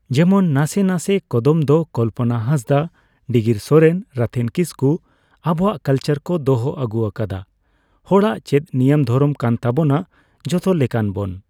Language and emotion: Santali, neutral